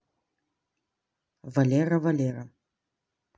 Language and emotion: Russian, neutral